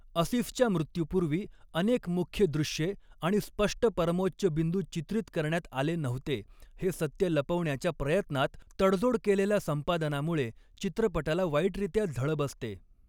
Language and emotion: Marathi, neutral